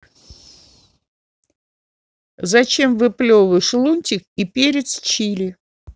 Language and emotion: Russian, angry